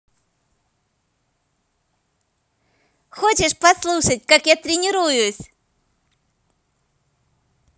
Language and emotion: Russian, positive